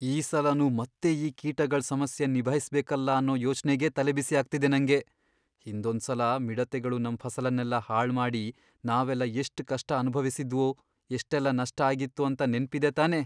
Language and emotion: Kannada, fearful